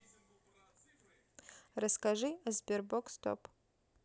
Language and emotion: Russian, neutral